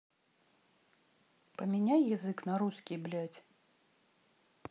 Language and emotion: Russian, angry